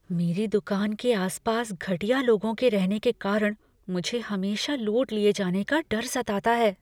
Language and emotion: Hindi, fearful